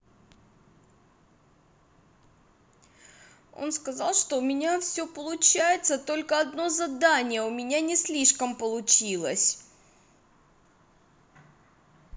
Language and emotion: Russian, sad